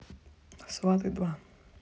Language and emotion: Russian, neutral